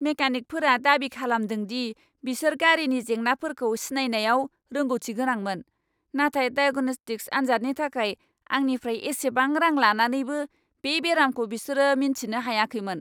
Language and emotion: Bodo, angry